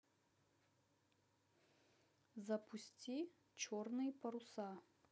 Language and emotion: Russian, neutral